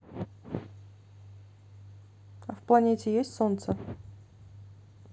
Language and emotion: Russian, neutral